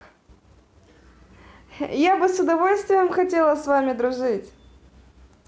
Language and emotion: Russian, positive